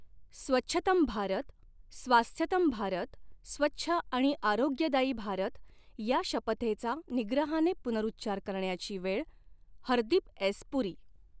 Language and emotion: Marathi, neutral